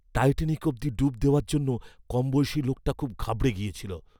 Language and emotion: Bengali, fearful